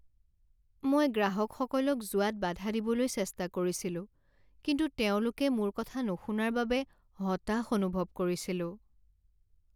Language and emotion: Assamese, sad